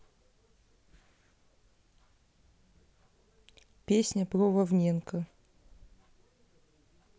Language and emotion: Russian, neutral